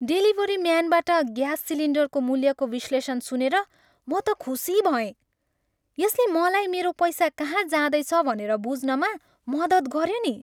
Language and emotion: Nepali, happy